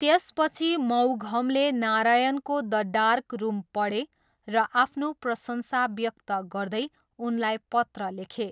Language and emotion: Nepali, neutral